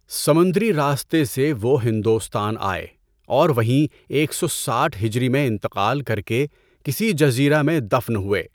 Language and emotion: Urdu, neutral